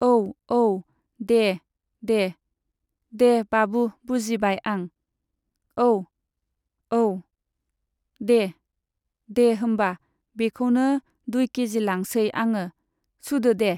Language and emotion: Bodo, neutral